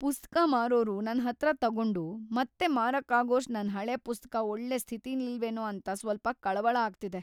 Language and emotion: Kannada, fearful